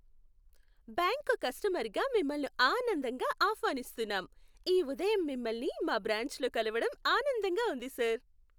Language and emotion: Telugu, happy